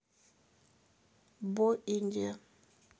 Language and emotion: Russian, neutral